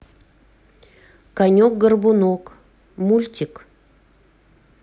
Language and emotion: Russian, neutral